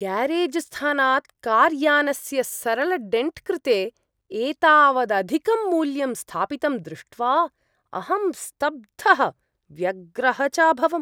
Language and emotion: Sanskrit, disgusted